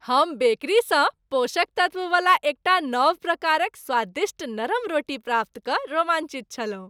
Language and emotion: Maithili, happy